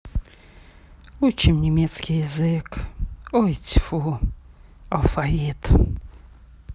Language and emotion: Russian, sad